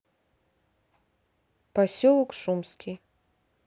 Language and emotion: Russian, neutral